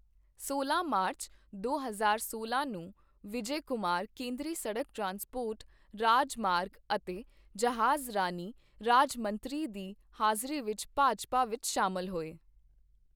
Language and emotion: Punjabi, neutral